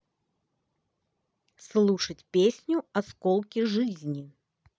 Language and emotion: Russian, positive